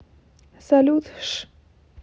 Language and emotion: Russian, neutral